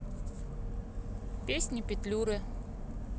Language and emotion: Russian, neutral